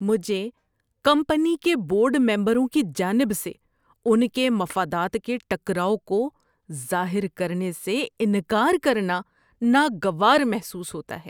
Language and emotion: Urdu, disgusted